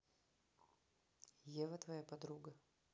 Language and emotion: Russian, neutral